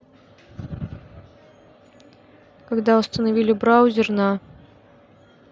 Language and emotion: Russian, neutral